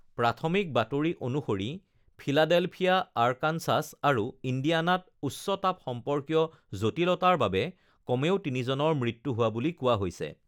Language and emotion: Assamese, neutral